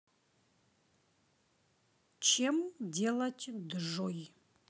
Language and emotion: Russian, neutral